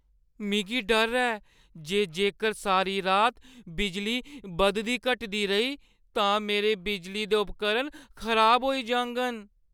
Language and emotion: Dogri, fearful